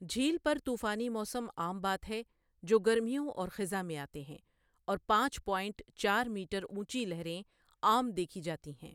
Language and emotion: Urdu, neutral